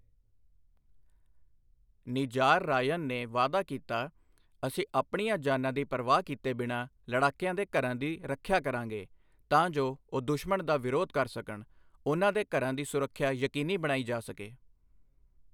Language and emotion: Punjabi, neutral